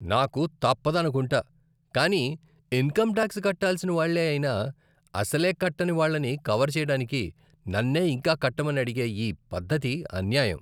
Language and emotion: Telugu, disgusted